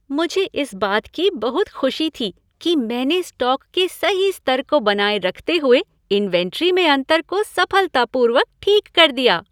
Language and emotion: Hindi, happy